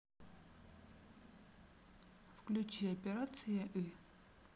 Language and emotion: Russian, neutral